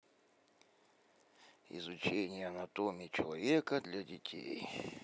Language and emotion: Russian, neutral